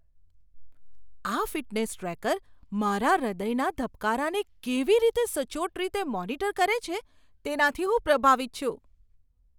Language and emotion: Gujarati, surprised